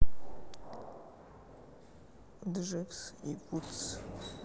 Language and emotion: Russian, sad